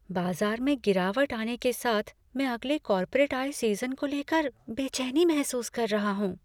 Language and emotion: Hindi, fearful